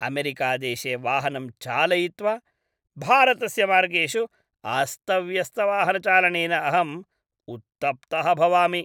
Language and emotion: Sanskrit, disgusted